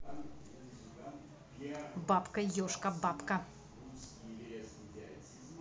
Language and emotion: Russian, neutral